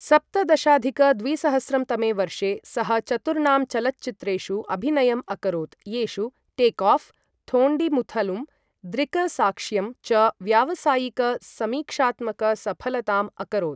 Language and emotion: Sanskrit, neutral